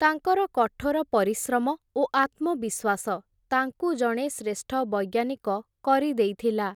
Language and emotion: Odia, neutral